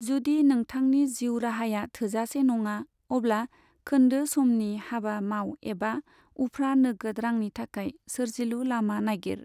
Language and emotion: Bodo, neutral